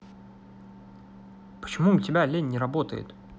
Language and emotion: Russian, angry